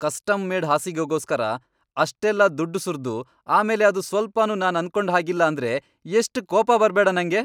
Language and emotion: Kannada, angry